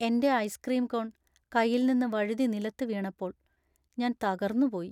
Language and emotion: Malayalam, sad